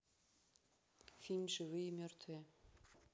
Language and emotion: Russian, neutral